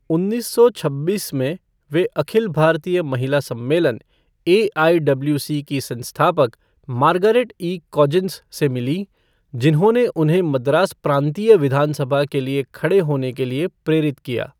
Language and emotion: Hindi, neutral